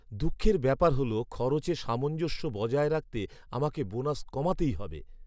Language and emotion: Bengali, sad